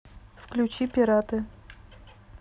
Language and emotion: Russian, neutral